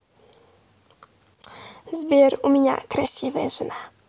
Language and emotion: Russian, positive